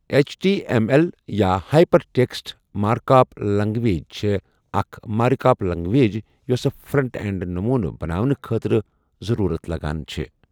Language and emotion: Kashmiri, neutral